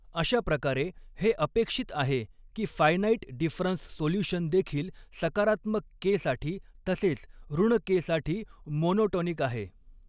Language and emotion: Marathi, neutral